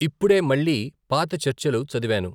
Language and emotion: Telugu, neutral